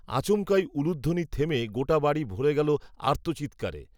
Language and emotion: Bengali, neutral